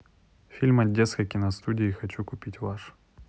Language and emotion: Russian, neutral